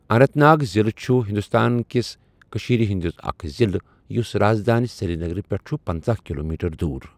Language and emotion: Kashmiri, neutral